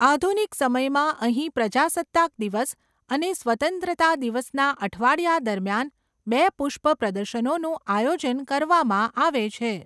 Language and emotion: Gujarati, neutral